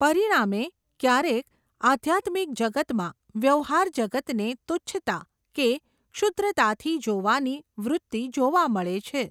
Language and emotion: Gujarati, neutral